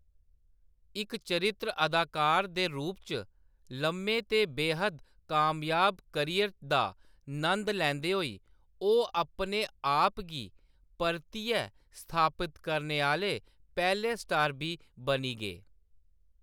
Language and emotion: Dogri, neutral